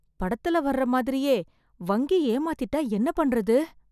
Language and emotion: Tamil, fearful